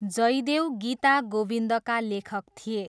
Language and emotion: Nepali, neutral